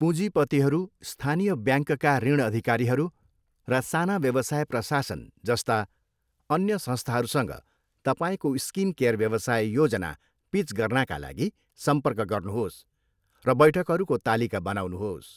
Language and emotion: Nepali, neutral